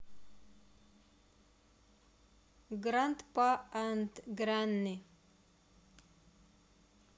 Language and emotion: Russian, neutral